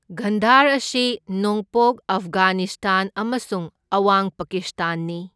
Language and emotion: Manipuri, neutral